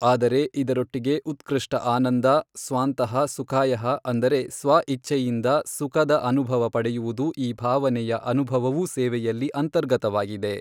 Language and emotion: Kannada, neutral